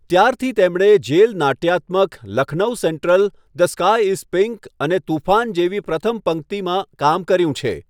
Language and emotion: Gujarati, neutral